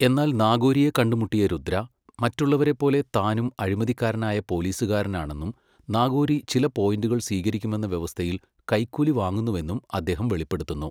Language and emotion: Malayalam, neutral